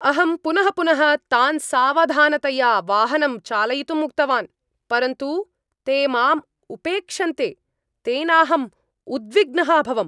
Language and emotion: Sanskrit, angry